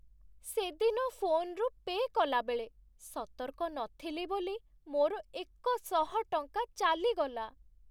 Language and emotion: Odia, sad